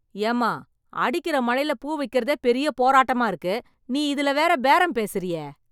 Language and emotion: Tamil, angry